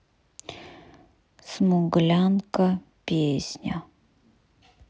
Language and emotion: Russian, neutral